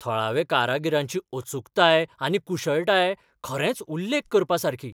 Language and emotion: Goan Konkani, surprised